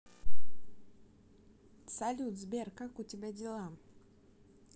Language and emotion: Russian, positive